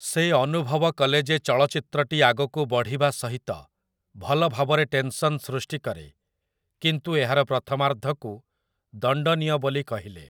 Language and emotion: Odia, neutral